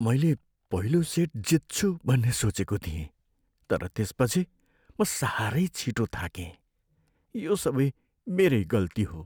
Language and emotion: Nepali, sad